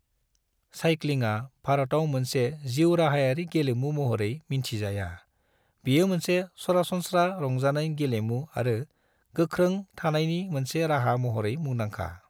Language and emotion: Bodo, neutral